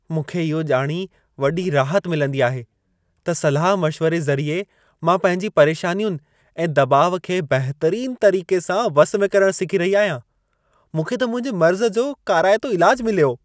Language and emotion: Sindhi, happy